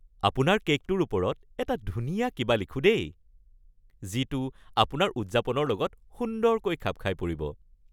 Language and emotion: Assamese, happy